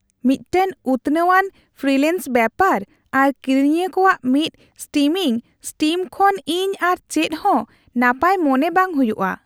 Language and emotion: Santali, happy